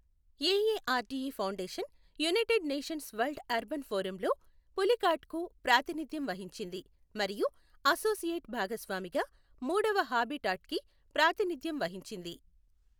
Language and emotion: Telugu, neutral